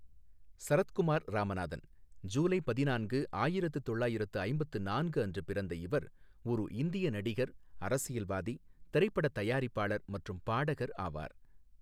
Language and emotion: Tamil, neutral